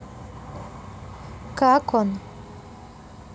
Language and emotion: Russian, neutral